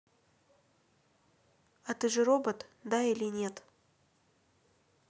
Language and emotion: Russian, neutral